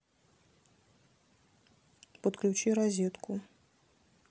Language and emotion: Russian, neutral